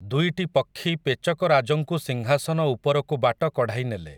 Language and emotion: Odia, neutral